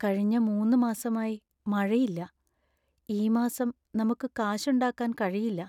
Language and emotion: Malayalam, sad